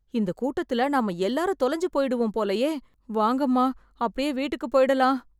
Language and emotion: Tamil, fearful